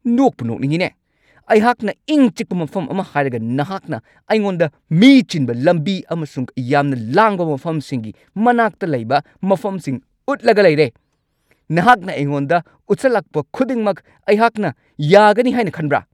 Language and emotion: Manipuri, angry